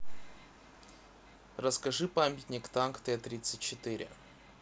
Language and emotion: Russian, neutral